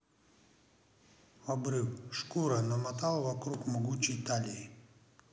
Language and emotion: Russian, neutral